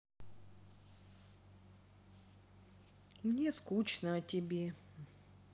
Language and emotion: Russian, sad